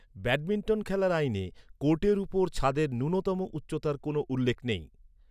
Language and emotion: Bengali, neutral